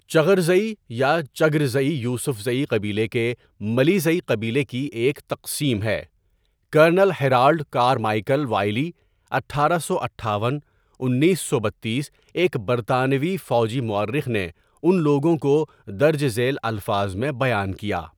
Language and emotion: Urdu, neutral